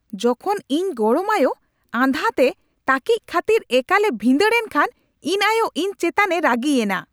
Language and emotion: Santali, angry